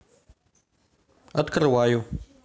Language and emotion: Russian, neutral